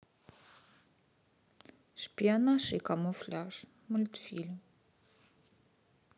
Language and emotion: Russian, sad